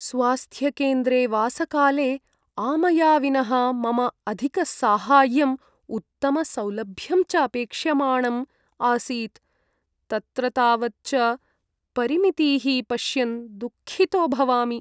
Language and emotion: Sanskrit, sad